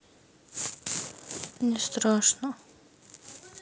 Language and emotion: Russian, sad